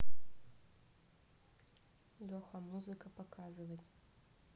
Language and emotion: Russian, neutral